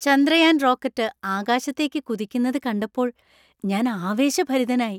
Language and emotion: Malayalam, happy